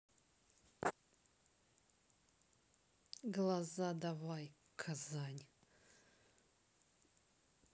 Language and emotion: Russian, angry